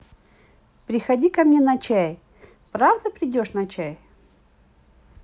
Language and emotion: Russian, positive